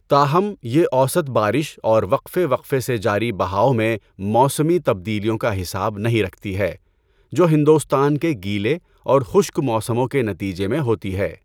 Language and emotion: Urdu, neutral